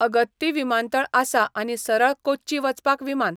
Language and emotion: Goan Konkani, neutral